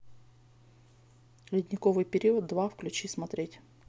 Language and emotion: Russian, neutral